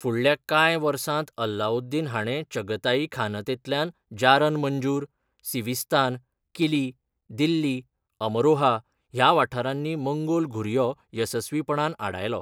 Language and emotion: Goan Konkani, neutral